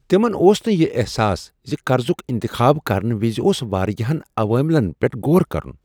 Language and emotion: Kashmiri, surprised